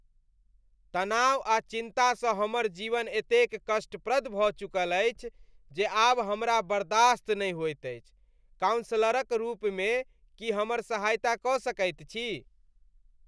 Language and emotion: Maithili, disgusted